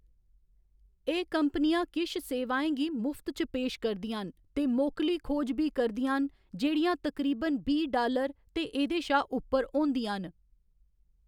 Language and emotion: Dogri, neutral